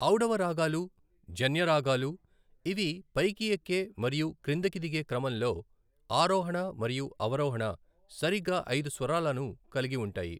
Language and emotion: Telugu, neutral